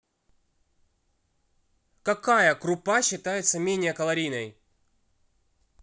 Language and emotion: Russian, neutral